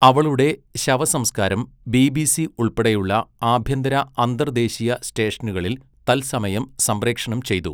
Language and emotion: Malayalam, neutral